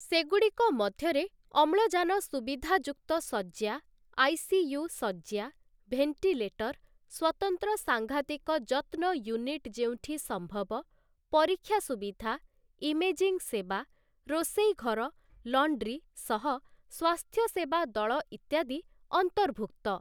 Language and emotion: Odia, neutral